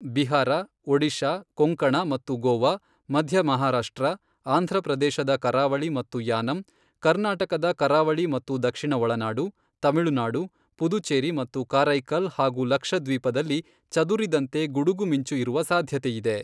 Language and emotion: Kannada, neutral